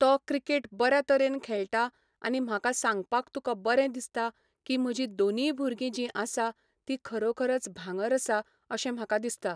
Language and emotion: Goan Konkani, neutral